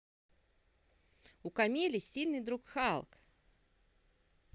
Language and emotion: Russian, positive